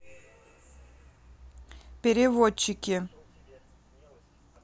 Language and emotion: Russian, neutral